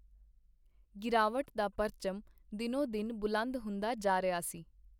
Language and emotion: Punjabi, neutral